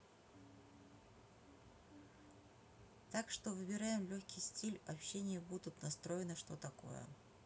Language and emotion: Russian, neutral